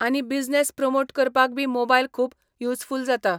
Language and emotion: Goan Konkani, neutral